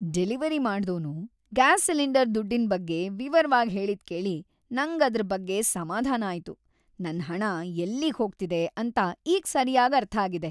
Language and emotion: Kannada, happy